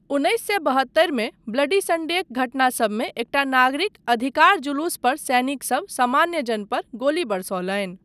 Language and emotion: Maithili, neutral